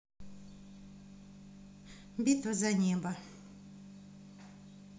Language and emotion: Russian, neutral